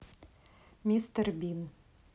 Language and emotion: Russian, neutral